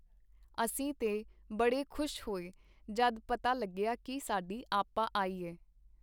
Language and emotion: Punjabi, neutral